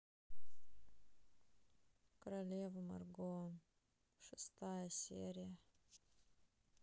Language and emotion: Russian, sad